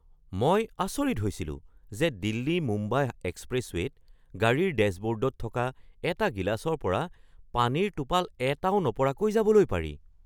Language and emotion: Assamese, surprised